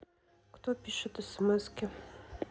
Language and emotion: Russian, neutral